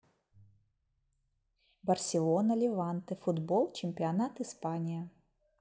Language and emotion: Russian, neutral